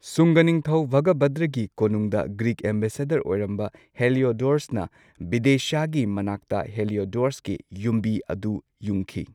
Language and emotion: Manipuri, neutral